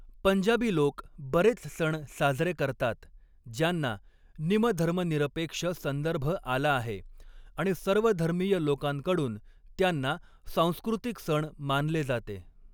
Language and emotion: Marathi, neutral